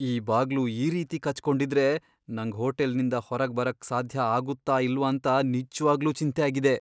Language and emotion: Kannada, fearful